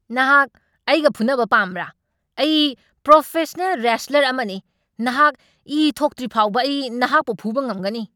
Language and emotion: Manipuri, angry